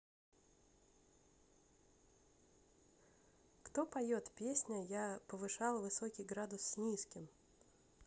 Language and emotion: Russian, neutral